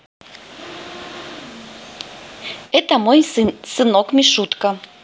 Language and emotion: Russian, positive